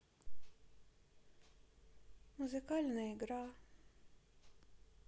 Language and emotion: Russian, sad